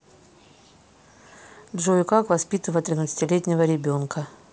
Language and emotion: Russian, neutral